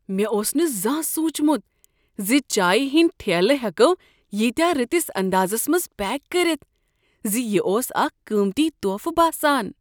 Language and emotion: Kashmiri, surprised